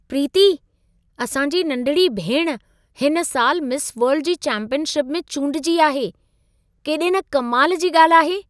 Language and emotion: Sindhi, surprised